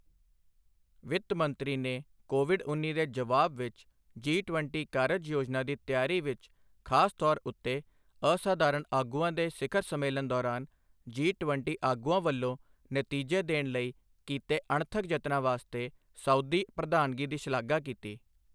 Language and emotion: Punjabi, neutral